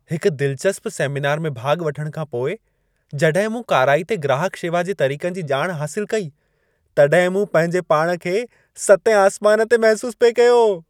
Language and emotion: Sindhi, happy